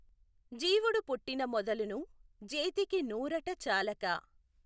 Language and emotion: Telugu, neutral